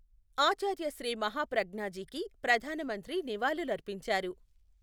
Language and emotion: Telugu, neutral